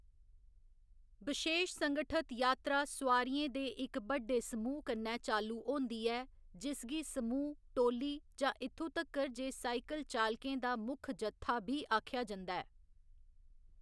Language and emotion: Dogri, neutral